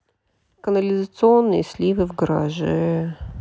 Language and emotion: Russian, sad